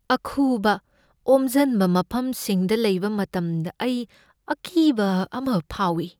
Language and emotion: Manipuri, fearful